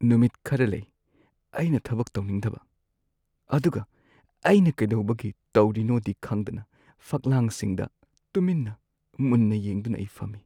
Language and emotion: Manipuri, sad